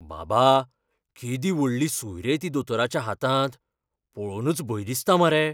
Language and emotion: Goan Konkani, fearful